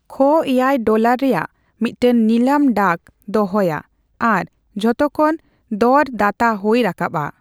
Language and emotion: Santali, neutral